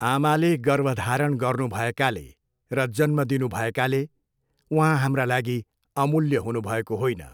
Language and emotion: Nepali, neutral